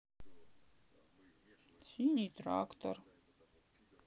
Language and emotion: Russian, sad